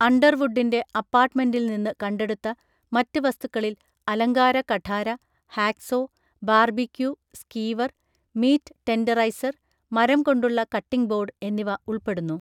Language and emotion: Malayalam, neutral